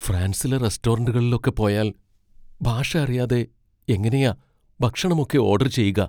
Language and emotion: Malayalam, fearful